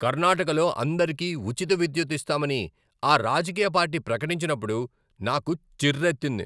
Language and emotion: Telugu, angry